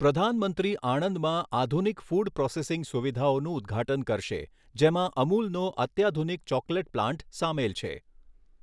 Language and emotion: Gujarati, neutral